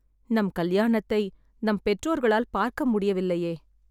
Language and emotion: Tamil, sad